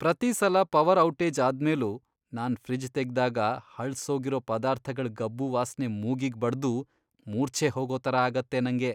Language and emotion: Kannada, disgusted